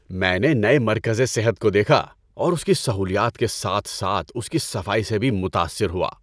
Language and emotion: Urdu, happy